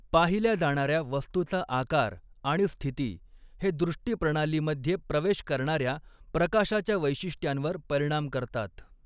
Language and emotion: Marathi, neutral